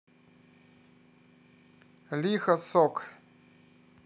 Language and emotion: Russian, positive